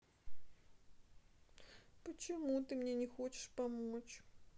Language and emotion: Russian, sad